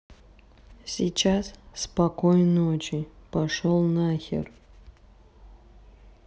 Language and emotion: Russian, neutral